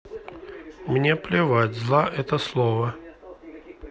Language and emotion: Russian, neutral